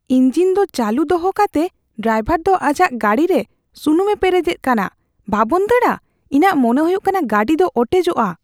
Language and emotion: Santali, fearful